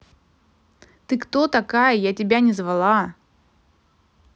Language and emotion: Russian, angry